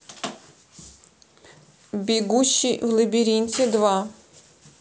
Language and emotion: Russian, neutral